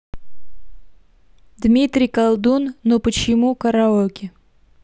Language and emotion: Russian, neutral